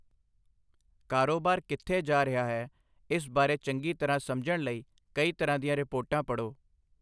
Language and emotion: Punjabi, neutral